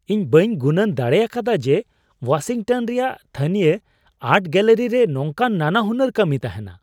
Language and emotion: Santali, surprised